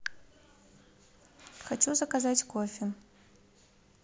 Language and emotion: Russian, neutral